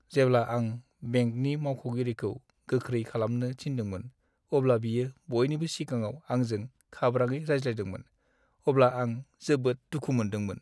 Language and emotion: Bodo, sad